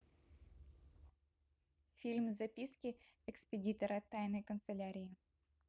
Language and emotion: Russian, neutral